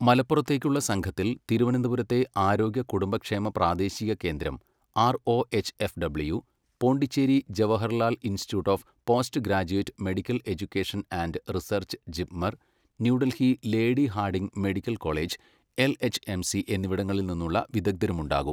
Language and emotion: Malayalam, neutral